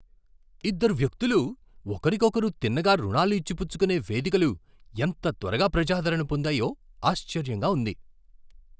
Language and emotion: Telugu, surprised